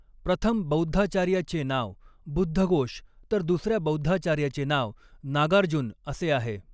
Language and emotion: Marathi, neutral